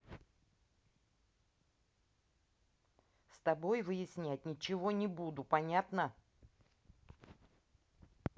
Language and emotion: Russian, angry